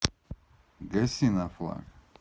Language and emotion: Russian, neutral